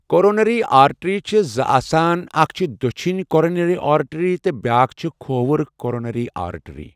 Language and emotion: Kashmiri, neutral